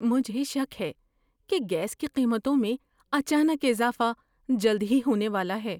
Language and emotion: Urdu, fearful